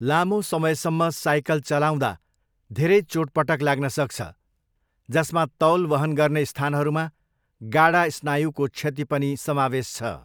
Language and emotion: Nepali, neutral